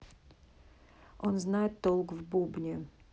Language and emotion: Russian, neutral